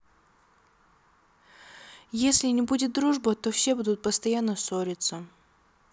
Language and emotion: Russian, sad